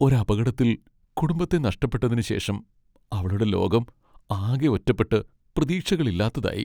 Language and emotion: Malayalam, sad